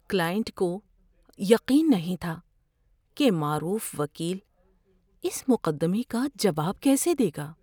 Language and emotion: Urdu, fearful